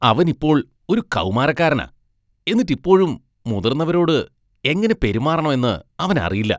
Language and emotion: Malayalam, disgusted